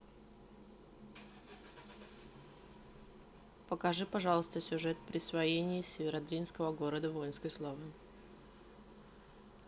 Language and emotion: Russian, neutral